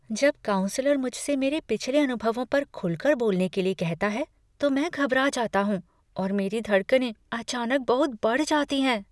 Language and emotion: Hindi, fearful